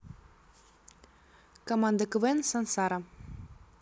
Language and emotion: Russian, neutral